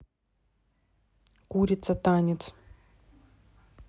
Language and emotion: Russian, neutral